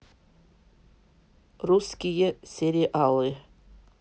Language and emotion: Russian, neutral